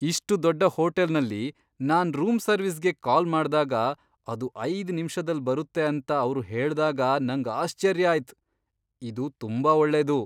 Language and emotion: Kannada, surprised